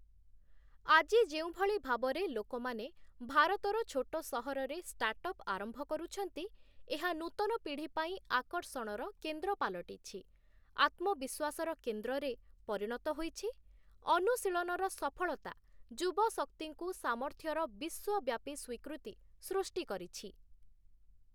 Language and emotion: Odia, neutral